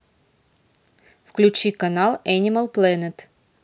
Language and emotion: Russian, neutral